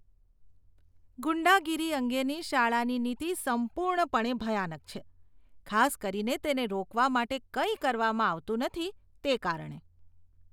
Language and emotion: Gujarati, disgusted